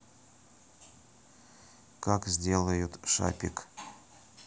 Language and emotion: Russian, neutral